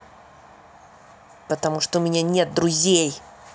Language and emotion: Russian, angry